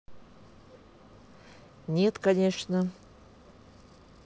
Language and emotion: Russian, neutral